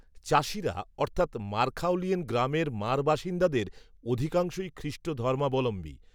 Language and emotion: Bengali, neutral